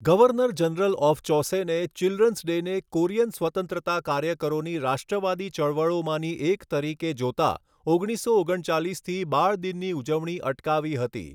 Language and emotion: Gujarati, neutral